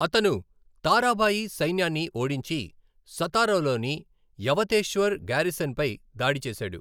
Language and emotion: Telugu, neutral